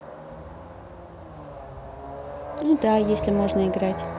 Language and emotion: Russian, neutral